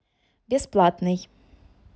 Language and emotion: Russian, neutral